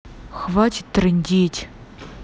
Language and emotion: Russian, angry